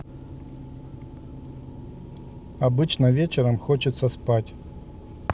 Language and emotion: Russian, neutral